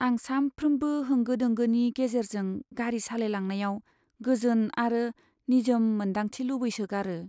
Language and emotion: Bodo, sad